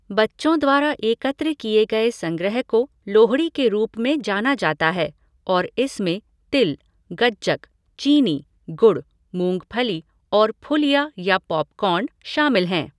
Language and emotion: Hindi, neutral